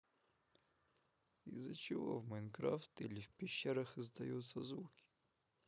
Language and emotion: Russian, neutral